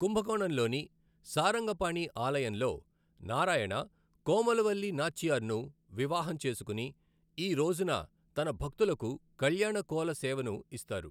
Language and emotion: Telugu, neutral